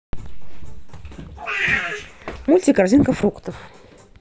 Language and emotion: Russian, neutral